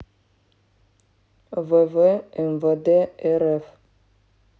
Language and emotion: Russian, neutral